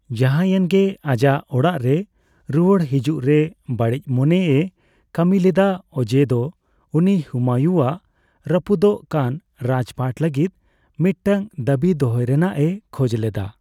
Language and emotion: Santali, neutral